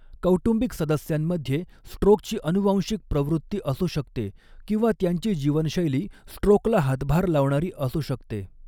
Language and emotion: Marathi, neutral